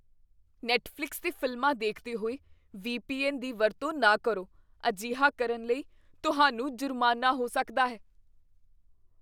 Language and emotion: Punjabi, fearful